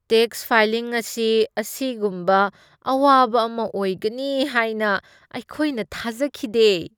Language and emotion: Manipuri, disgusted